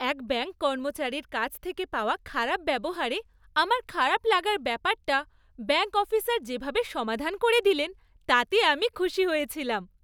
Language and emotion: Bengali, happy